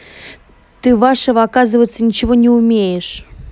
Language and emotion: Russian, angry